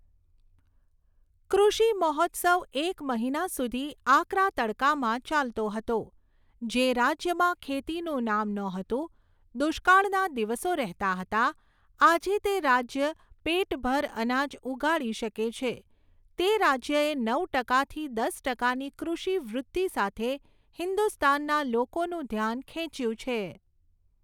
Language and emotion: Gujarati, neutral